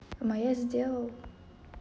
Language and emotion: Russian, neutral